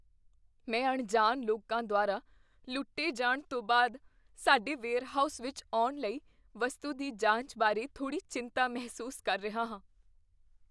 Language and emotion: Punjabi, fearful